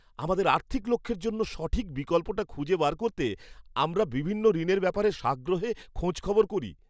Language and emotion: Bengali, happy